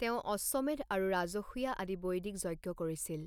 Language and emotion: Assamese, neutral